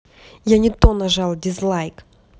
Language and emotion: Russian, angry